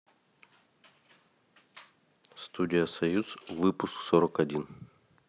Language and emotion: Russian, neutral